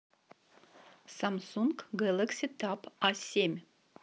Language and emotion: Russian, neutral